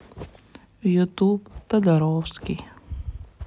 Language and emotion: Russian, sad